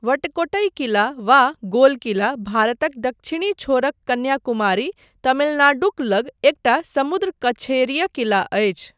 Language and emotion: Maithili, neutral